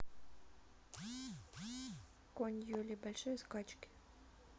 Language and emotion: Russian, neutral